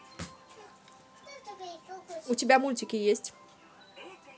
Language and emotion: Russian, neutral